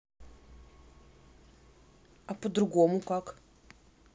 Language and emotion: Russian, neutral